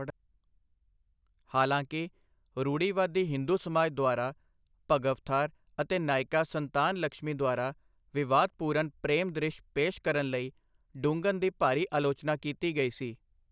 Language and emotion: Punjabi, neutral